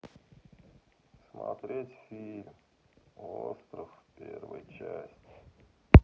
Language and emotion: Russian, sad